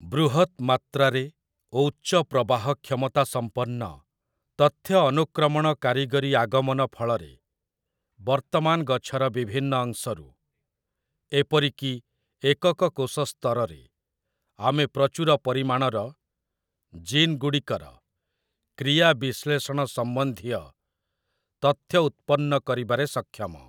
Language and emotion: Odia, neutral